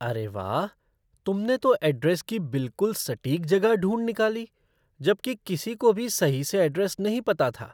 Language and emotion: Hindi, surprised